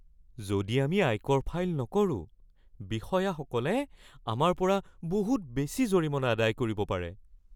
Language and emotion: Assamese, fearful